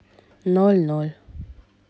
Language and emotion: Russian, neutral